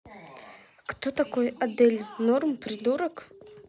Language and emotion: Russian, neutral